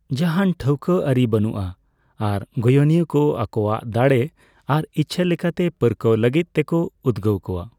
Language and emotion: Santali, neutral